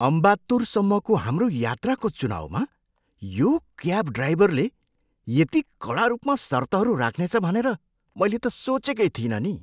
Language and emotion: Nepali, surprised